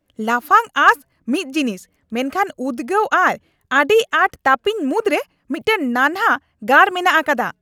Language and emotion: Santali, angry